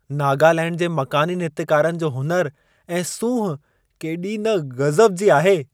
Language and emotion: Sindhi, surprised